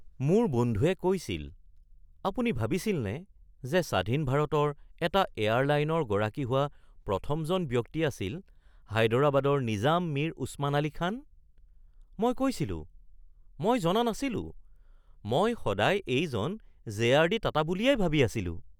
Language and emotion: Assamese, surprised